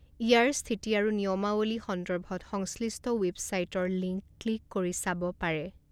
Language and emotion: Assamese, neutral